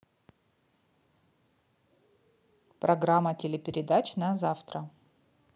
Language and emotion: Russian, neutral